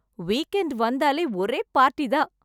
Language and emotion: Tamil, happy